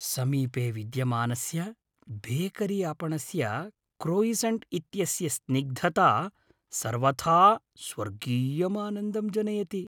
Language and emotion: Sanskrit, happy